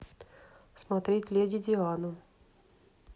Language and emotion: Russian, neutral